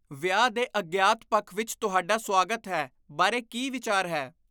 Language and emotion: Punjabi, disgusted